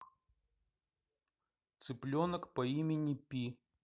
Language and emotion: Russian, neutral